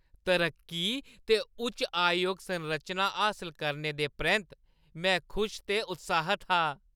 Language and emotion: Dogri, happy